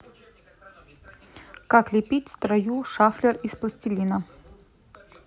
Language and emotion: Russian, neutral